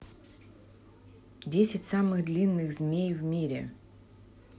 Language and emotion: Russian, neutral